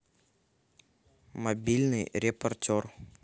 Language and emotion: Russian, neutral